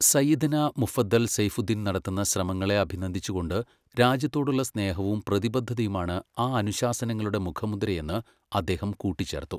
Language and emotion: Malayalam, neutral